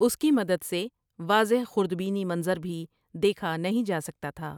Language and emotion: Urdu, neutral